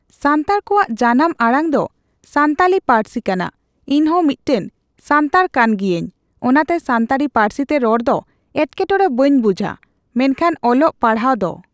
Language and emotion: Santali, neutral